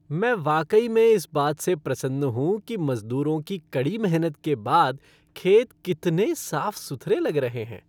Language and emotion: Hindi, happy